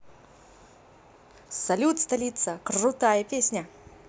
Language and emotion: Russian, positive